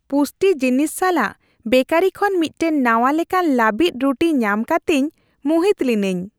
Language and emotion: Santali, happy